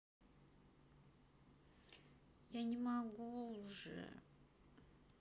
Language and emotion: Russian, sad